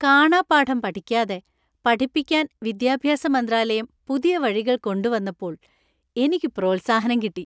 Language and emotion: Malayalam, happy